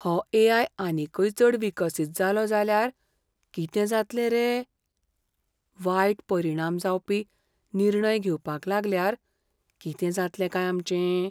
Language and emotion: Goan Konkani, fearful